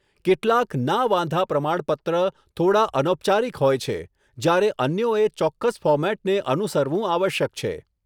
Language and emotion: Gujarati, neutral